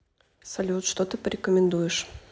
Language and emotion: Russian, neutral